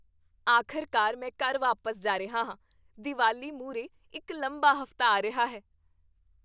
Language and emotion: Punjabi, happy